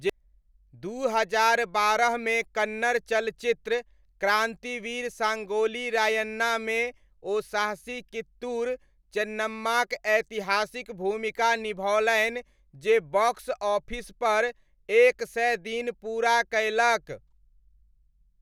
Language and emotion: Maithili, neutral